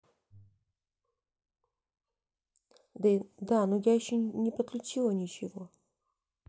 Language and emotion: Russian, sad